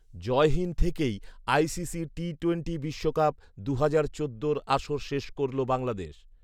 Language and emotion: Bengali, neutral